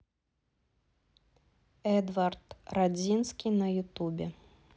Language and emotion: Russian, neutral